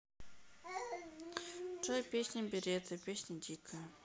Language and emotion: Russian, neutral